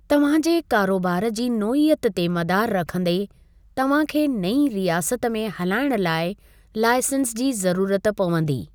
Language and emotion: Sindhi, neutral